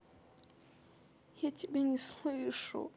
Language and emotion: Russian, sad